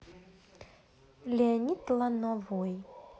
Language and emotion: Russian, neutral